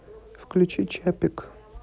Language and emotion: Russian, neutral